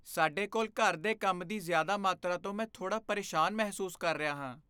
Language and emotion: Punjabi, fearful